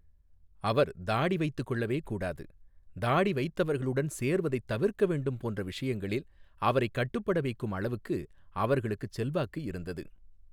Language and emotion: Tamil, neutral